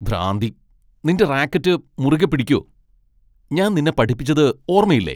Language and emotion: Malayalam, angry